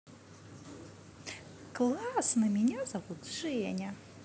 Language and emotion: Russian, positive